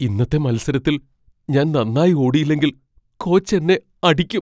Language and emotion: Malayalam, fearful